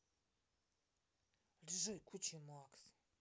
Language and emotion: Russian, angry